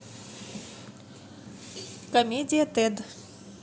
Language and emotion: Russian, neutral